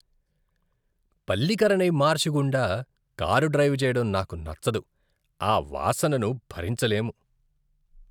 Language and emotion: Telugu, disgusted